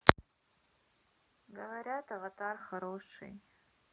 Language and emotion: Russian, sad